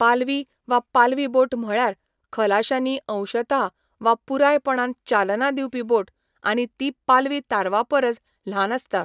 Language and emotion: Goan Konkani, neutral